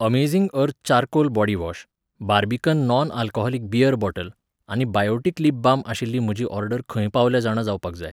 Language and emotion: Goan Konkani, neutral